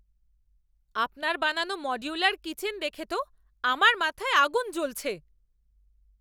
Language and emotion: Bengali, angry